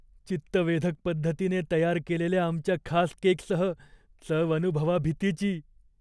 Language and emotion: Marathi, fearful